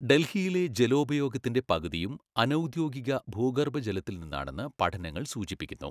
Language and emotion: Malayalam, neutral